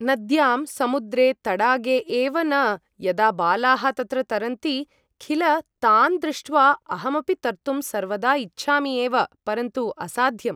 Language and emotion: Sanskrit, neutral